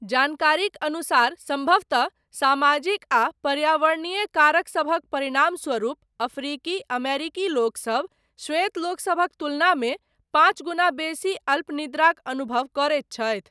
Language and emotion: Maithili, neutral